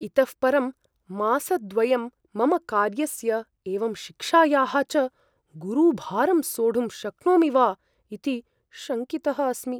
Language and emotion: Sanskrit, fearful